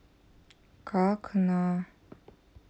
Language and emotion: Russian, sad